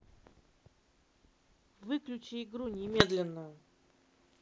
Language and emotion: Russian, angry